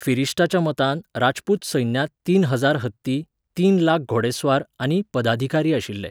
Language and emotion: Goan Konkani, neutral